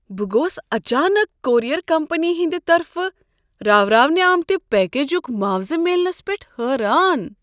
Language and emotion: Kashmiri, surprised